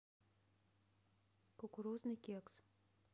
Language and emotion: Russian, neutral